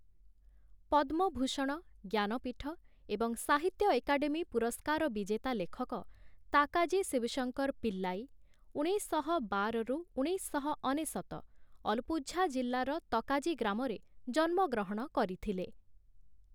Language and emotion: Odia, neutral